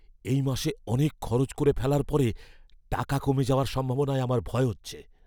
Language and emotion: Bengali, fearful